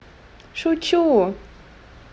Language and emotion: Russian, positive